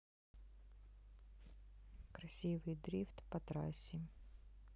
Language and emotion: Russian, sad